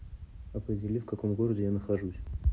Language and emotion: Russian, neutral